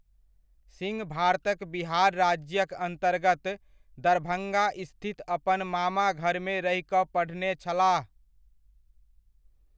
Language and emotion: Maithili, neutral